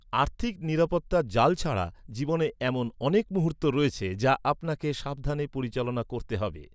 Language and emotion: Bengali, neutral